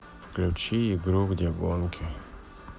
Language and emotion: Russian, neutral